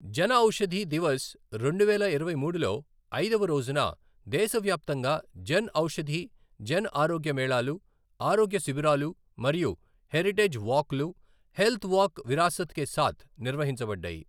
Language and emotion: Telugu, neutral